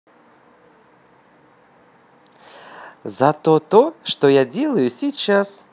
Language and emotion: Russian, positive